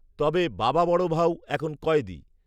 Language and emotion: Bengali, neutral